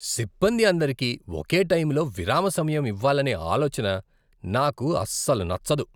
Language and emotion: Telugu, disgusted